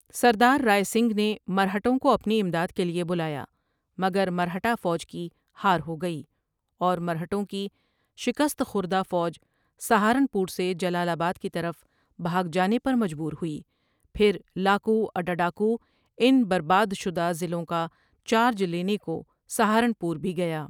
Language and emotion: Urdu, neutral